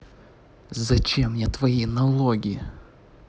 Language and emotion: Russian, angry